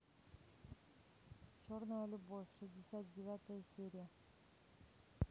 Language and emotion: Russian, neutral